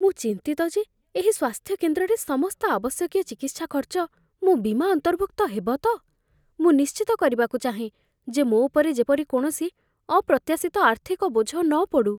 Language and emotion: Odia, fearful